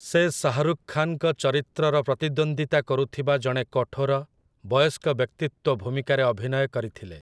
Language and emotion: Odia, neutral